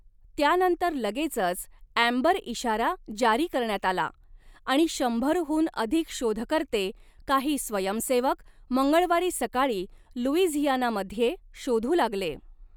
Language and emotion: Marathi, neutral